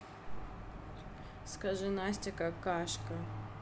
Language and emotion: Russian, neutral